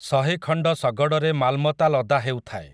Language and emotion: Odia, neutral